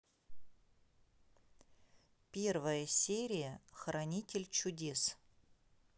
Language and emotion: Russian, neutral